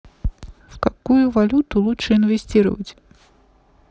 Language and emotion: Russian, neutral